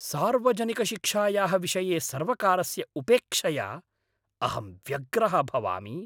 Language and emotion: Sanskrit, angry